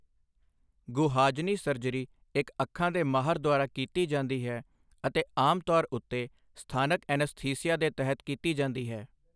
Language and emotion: Punjabi, neutral